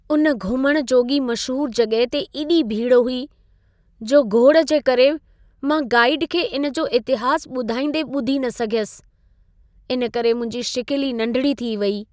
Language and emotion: Sindhi, sad